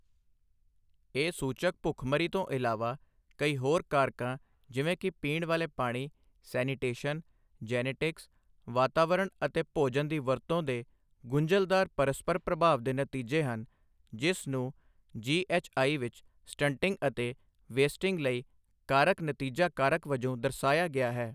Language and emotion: Punjabi, neutral